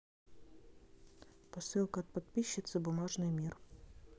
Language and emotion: Russian, neutral